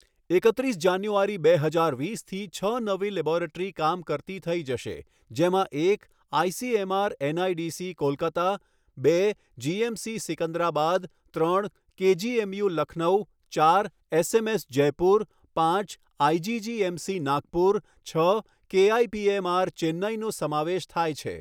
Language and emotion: Gujarati, neutral